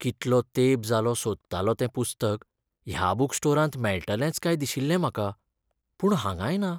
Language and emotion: Goan Konkani, sad